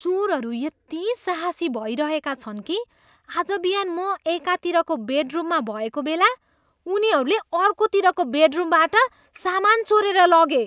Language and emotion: Nepali, disgusted